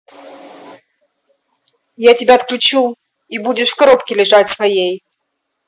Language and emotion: Russian, angry